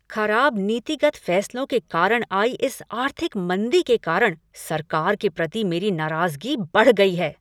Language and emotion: Hindi, angry